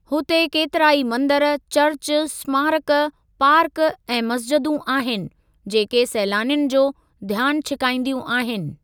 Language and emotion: Sindhi, neutral